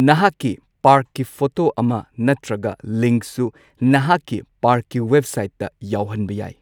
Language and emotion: Manipuri, neutral